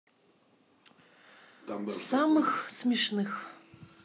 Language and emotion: Russian, neutral